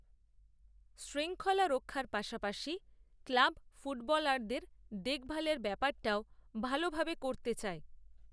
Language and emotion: Bengali, neutral